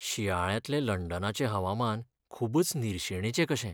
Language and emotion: Goan Konkani, sad